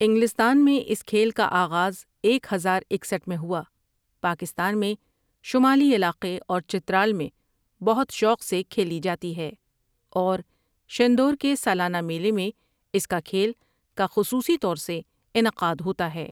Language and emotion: Urdu, neutral